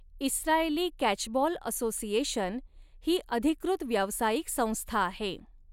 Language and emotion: Marathi, neutral